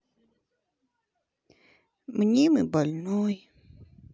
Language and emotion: Russian, sad